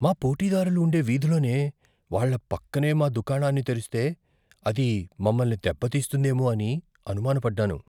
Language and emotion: Telugu, fearful